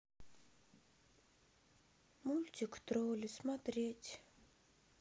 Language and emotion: Russian, sad